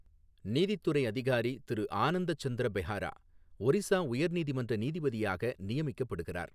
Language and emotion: Tamil, neutral